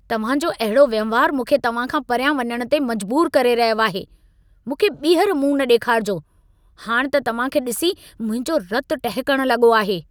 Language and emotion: Sindhi, angry